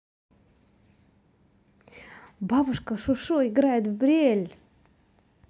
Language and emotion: Russian, positive